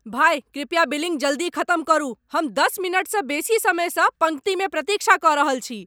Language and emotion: Maithili, angry